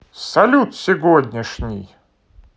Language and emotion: Russian, positive